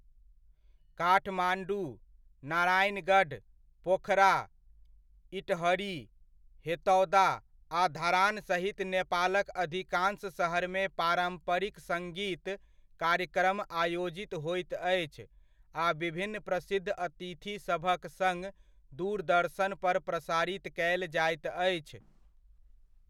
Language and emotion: Maithili, neutral